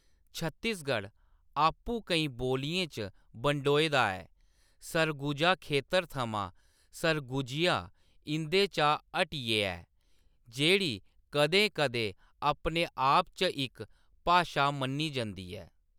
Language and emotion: Dogri, neutral